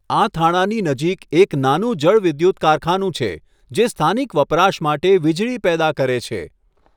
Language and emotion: Gujarati, neutral